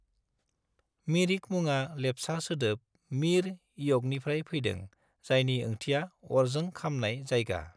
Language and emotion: Bodo, neutral